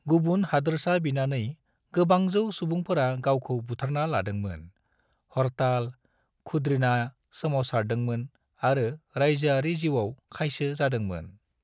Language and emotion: Bodo, neutral